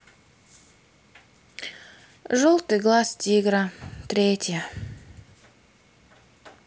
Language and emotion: Russian, sad